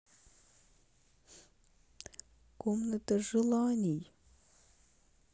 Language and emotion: Russian, sad